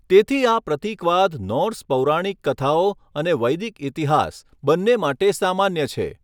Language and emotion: Gujarati, neutral